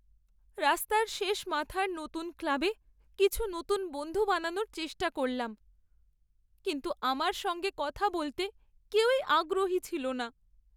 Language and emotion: Bengali, sad